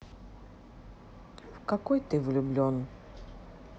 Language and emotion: Russian, sad